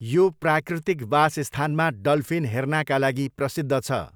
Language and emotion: Nepali, neutral